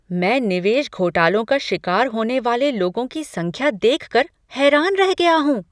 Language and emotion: Hindi, surprised